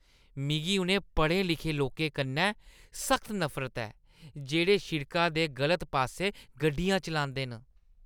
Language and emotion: Dogri, disgusted